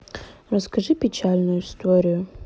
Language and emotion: Russian, sad